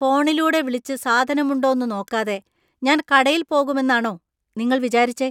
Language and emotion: Malayalam, disgusted